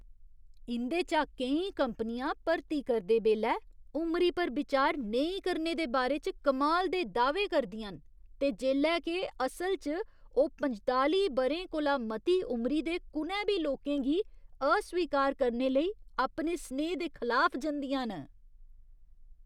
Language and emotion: Dogri, disgusted